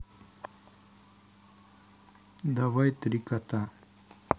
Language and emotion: Russian, neutral